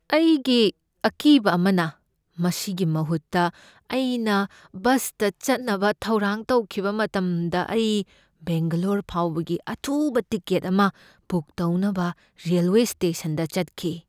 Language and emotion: Manipuri, fearful